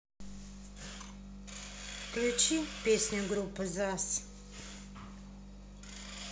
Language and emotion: Russian, neutral